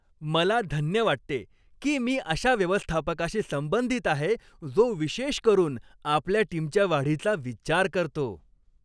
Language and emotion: Marathi, happy